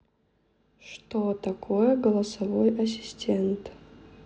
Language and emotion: Russian, neutral